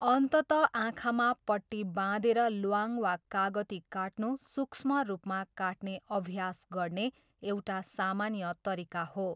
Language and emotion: Nepali, neutral